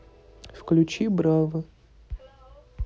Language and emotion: Russian, neutral